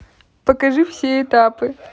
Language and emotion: Russian, positive